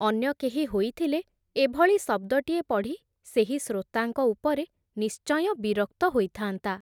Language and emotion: Odia, neutral